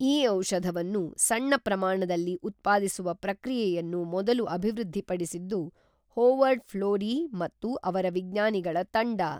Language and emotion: Kannada, neutral